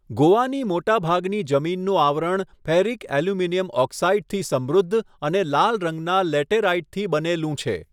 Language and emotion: Gujarati, neutral